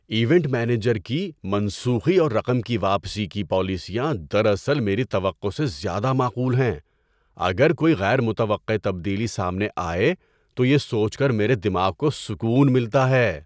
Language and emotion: Urdu, surprised